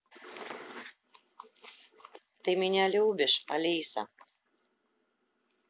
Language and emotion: Russian, sad